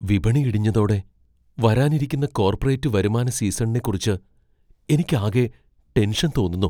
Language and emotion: Malayalam, fearful